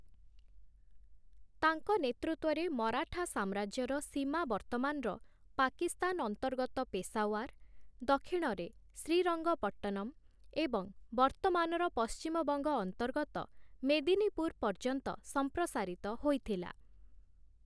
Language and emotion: Odia, neutral